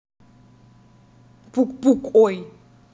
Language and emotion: Russian, neutral